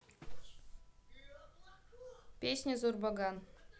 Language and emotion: Russian, neutral